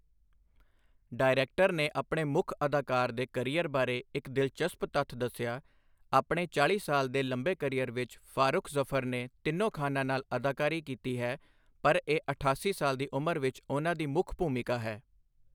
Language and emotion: Punjabi, neutral